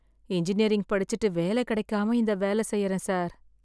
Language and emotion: Tamil, sad